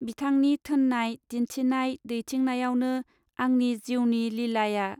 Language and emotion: Bodo, neutral